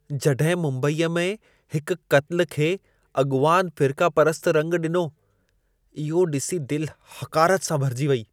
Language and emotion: Sindhi, disgusted